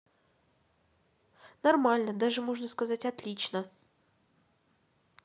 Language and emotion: Russian, neutral